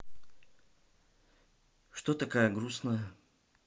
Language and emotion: Russian, neutral